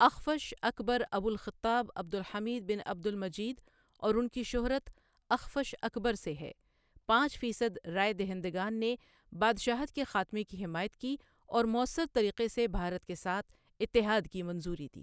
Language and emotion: Urdu, neutral